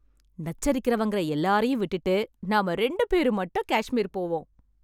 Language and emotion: Tamil, happy